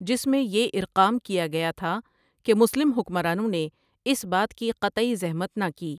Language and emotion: Urdu, neutral